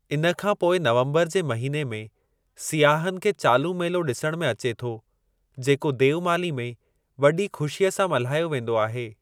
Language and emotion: Sindhi, neutral